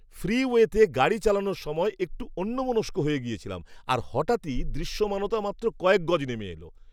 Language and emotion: Bengali, surprised